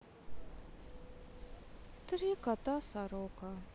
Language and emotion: Russian, sad